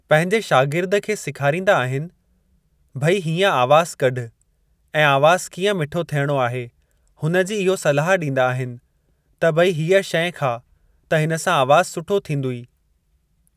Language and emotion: Sindhi, neutral